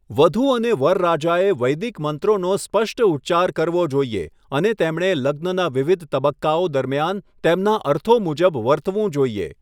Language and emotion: Gujarati, neutral